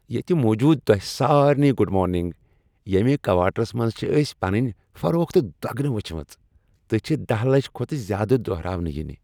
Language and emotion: Kashmiri, happy